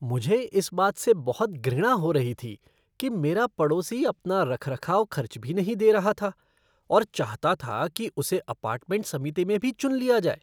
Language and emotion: Hindi, disgusted